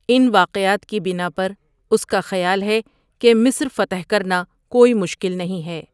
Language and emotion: Urdu, neutral